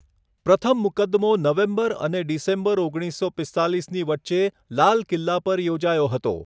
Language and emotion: Gujarati, neutral